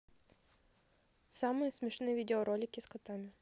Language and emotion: Russian, neutral